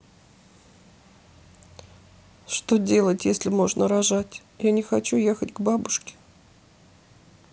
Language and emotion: Russian, sad